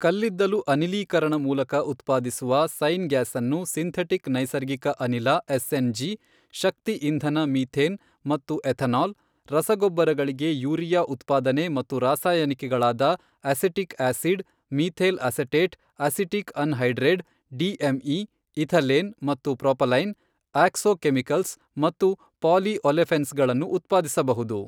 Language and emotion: Kannada, neutral